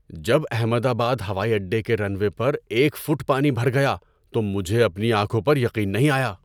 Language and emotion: Urdu, surprised